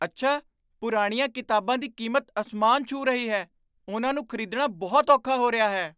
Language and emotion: Punjabi, surprised